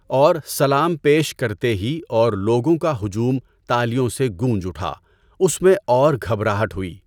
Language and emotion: Urdu, neutral